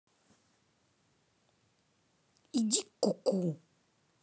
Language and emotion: Russian, angry